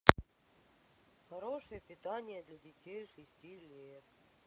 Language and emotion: Russian, neutral